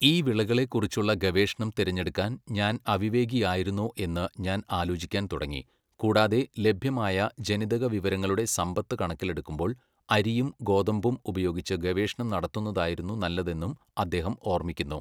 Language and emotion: Malayalam, neutral